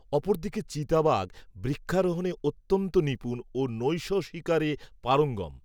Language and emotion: Bengali, neutral